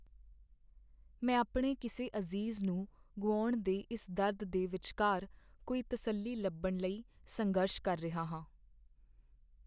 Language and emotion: Punjabi, sad